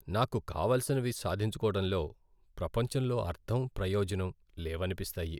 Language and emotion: Telugu, sad